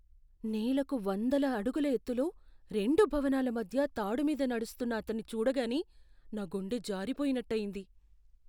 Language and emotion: Telugu, fearful